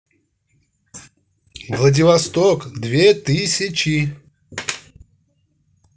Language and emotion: Russian, positive